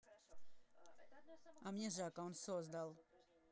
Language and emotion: Russian, neutral